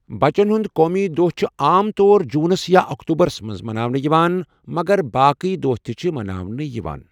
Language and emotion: Kashmiri, neutral